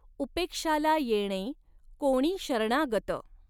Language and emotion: Marathi, neutral